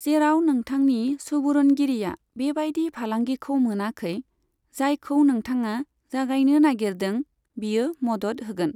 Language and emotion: Bodo, neutral